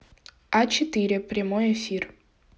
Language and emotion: Russian, neutral